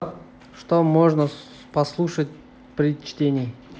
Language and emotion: Russian, neutral